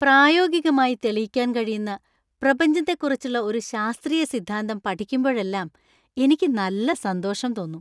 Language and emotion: Malayalam, happy